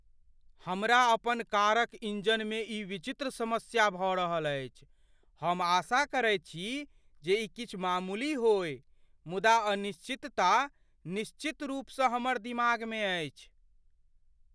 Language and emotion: Maithili, fearful